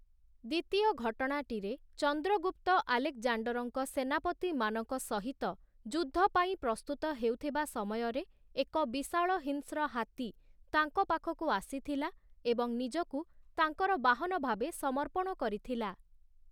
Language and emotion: Odia, neutral